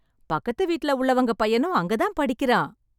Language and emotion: Tamil, happy